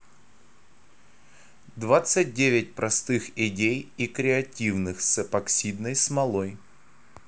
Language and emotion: Russian, neutral